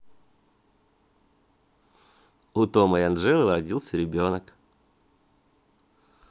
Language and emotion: Russian, positive